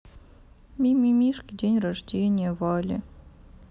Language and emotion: Russian, sad